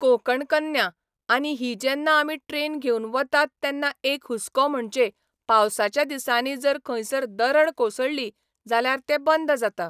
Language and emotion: Goan Konkani, neutral